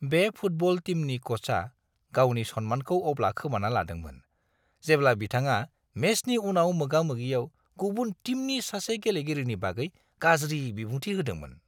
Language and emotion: Bodo, disgusted